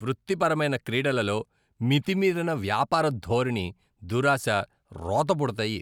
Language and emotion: Telugu, disgusted